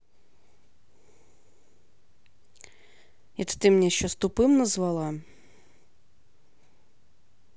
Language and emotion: Russian, angry